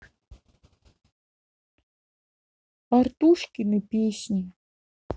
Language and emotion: Russian, sad